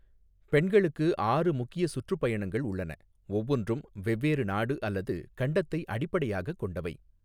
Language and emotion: Tamil, neutral